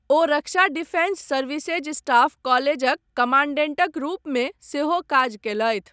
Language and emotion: Maithili, neutral